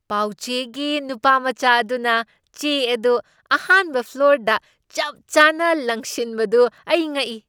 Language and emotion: Manipuri, surprised